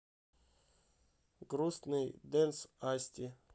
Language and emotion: Russian, neutral